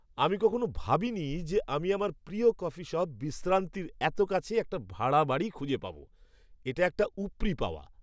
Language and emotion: Bengali, surprised